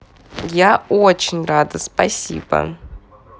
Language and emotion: Russian, positive